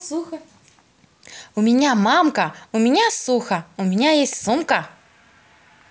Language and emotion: Russian, positive